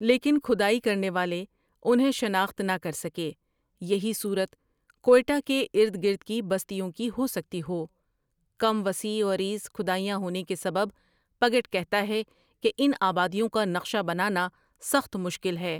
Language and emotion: Urdu, neutral